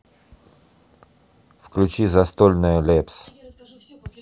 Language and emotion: Russian, neutral